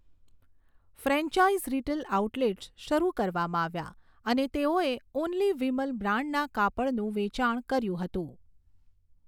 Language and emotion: Gujarati, neutral